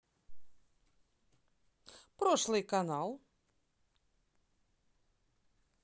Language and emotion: Russian, positive